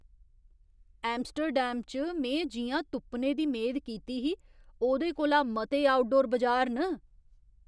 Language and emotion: Dogri, surprised